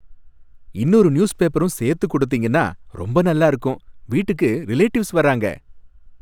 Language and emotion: Tamil, happy